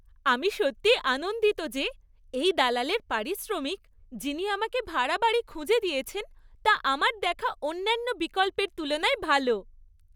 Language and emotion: Bengali, happy